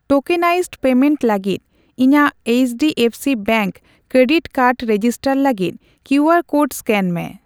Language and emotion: Santali, neutral